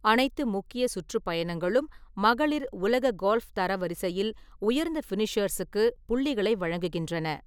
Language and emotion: Tamil, neutral